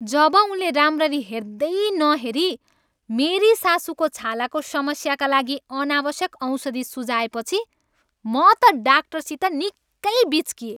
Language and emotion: Nepali, angry